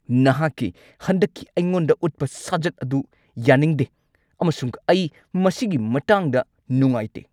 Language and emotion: Manipuri, angry